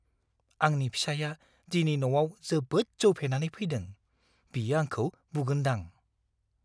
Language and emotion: Bodo, fearful